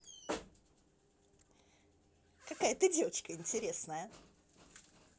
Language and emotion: Russian, positive